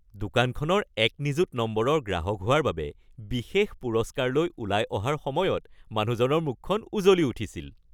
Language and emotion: Assamese, happy